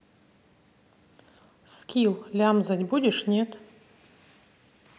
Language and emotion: Russian, neutral